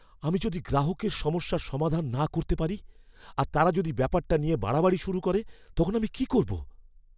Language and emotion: Bengali, fearful